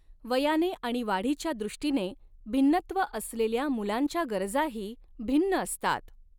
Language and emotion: Marathi, neutral